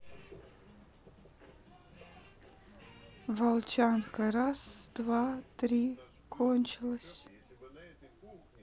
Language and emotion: Russian, neutral